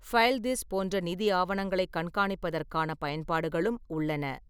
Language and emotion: Tamil, neutral